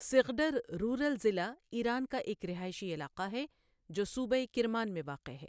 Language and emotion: Urdu, neutral